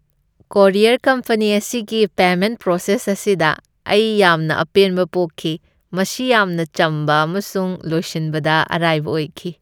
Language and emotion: Manipuri, happy